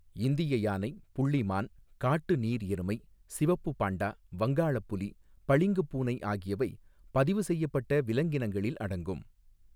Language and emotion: Tamil, neutral